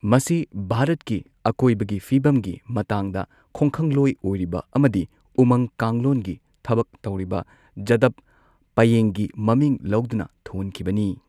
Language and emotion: Manipuri, neutral